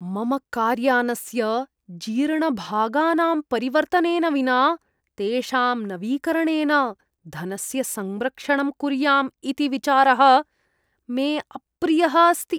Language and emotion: Sanskrit, disgusted